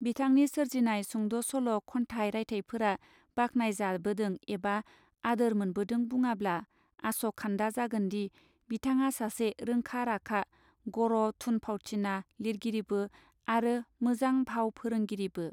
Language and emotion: Bodo, neutral